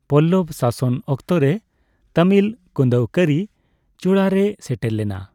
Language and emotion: Santali, neutral